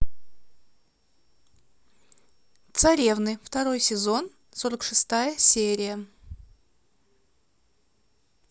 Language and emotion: Russian, neutral